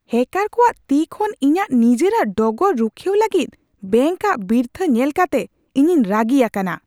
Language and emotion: Santali, angry